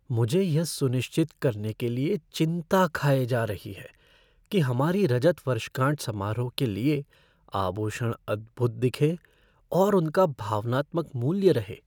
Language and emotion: Hindi, fearful